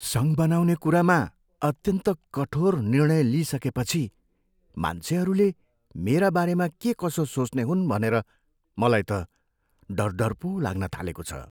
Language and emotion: Nepali, fearful